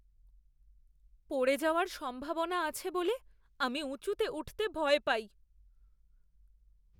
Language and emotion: Bengali, fearful